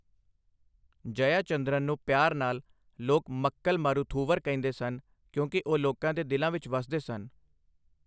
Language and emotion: Punjabi, neutral